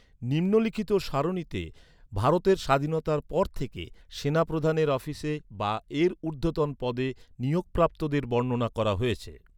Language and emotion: Bengali, neutral